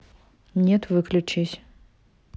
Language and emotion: Russian, neutral